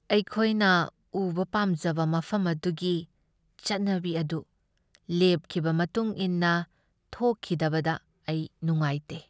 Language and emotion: Manipuri, sad